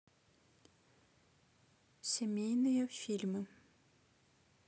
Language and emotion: Russian, neutral